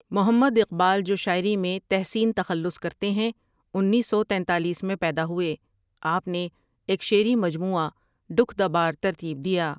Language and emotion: Urdu, neutral